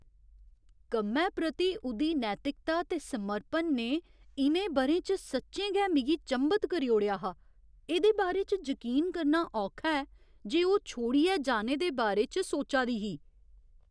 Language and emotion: Dogri, surprised